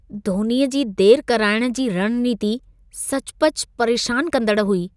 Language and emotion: Sindhi, disgusted